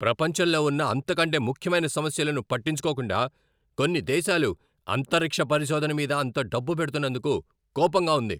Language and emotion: Telugu, angry